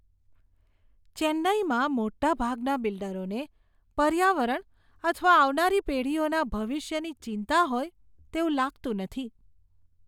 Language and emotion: Gujarati, disgusted